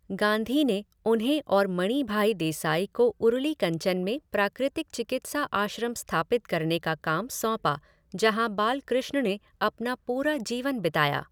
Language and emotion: Hindi, neutral